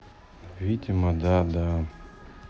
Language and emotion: Russian, sad